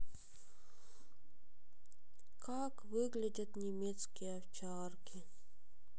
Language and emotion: Russian, sad